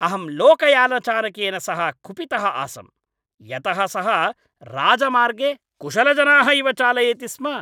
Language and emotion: Sanskrit, angry